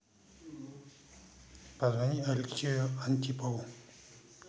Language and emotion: Russian, neutral